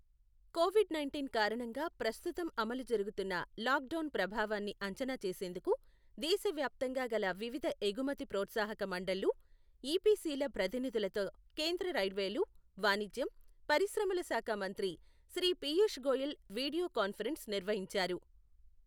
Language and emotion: Telugu, neutral